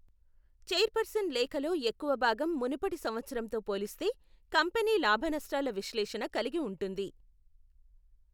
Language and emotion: Telugu, neutral